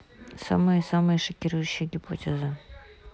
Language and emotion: Russian, neutral